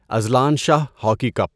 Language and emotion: Urdu, neutral